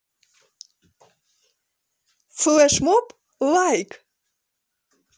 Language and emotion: Russian, positive